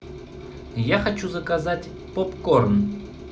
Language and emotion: Russian, neutral